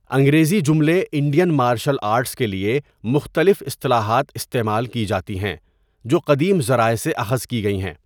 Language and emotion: Urdu, neutral